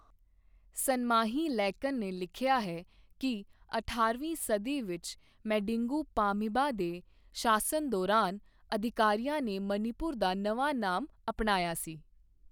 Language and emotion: Punjabi, neutral